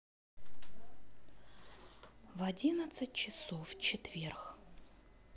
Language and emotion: Russian, neutral